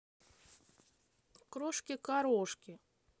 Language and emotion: Russian, positive